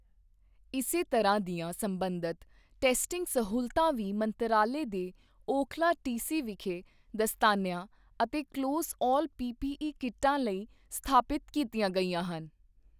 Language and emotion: Punjabi, neutral